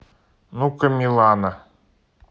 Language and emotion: Russian, neutral